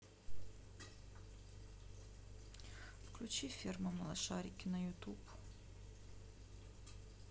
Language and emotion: Russian, sad